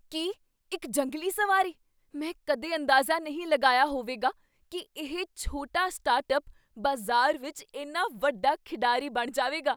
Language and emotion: Punjabi, surprised